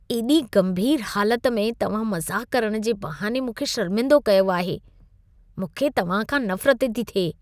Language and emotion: Sindhi, disgusted